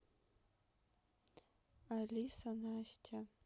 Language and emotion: Russian, neutral